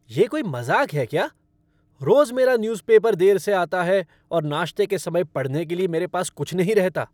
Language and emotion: Hindi, angry